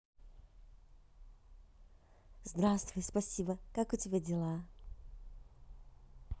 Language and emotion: Russian, positive